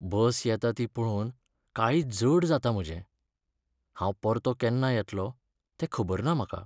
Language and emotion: Goan Konkani, sad